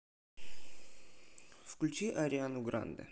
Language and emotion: Russian, neutral